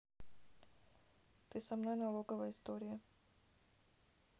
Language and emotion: Russian, neutral